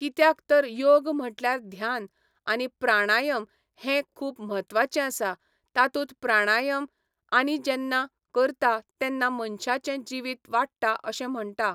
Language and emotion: Goan Konkani, neutral